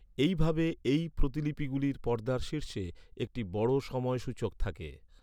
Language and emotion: Bengali, neutral